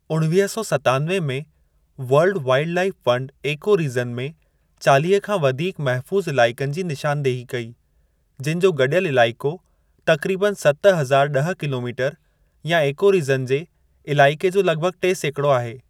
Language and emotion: Sindhi, neutral